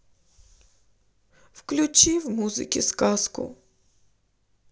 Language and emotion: Russian, sad